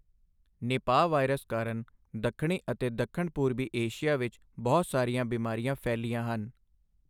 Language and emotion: Punjabi, neutral